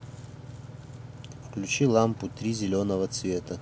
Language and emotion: Russian, neutral